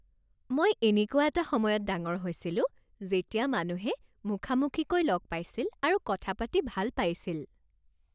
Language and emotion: Assamese, happy